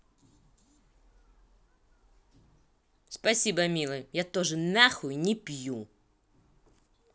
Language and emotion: Russian, angry